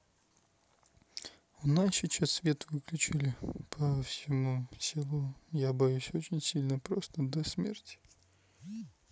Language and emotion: Russian, neutral